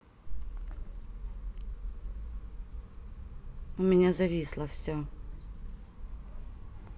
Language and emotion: Russian, neutral